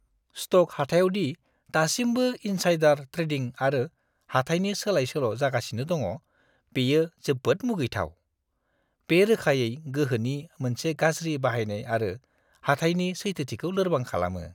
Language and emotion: Bodo, disgusted